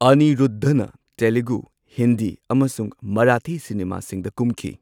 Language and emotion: Manipuri, neutral